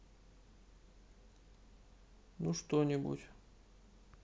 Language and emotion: Russian, sad